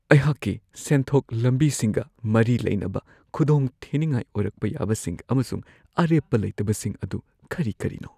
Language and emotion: Manipuri, fearful